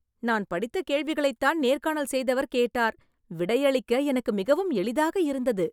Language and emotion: Tamil, happy